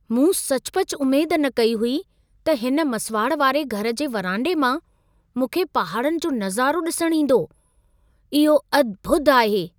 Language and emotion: Sindhi, surprised